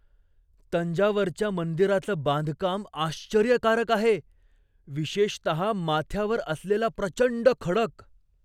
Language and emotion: Marathi, surprised